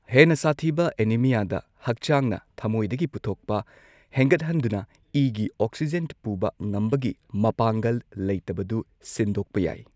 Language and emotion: Manipuri, neutral